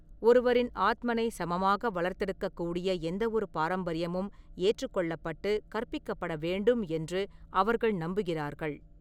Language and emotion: Tamil, neutral